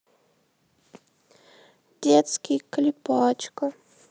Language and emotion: Russian, sad